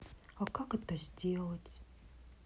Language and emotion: Russian, sad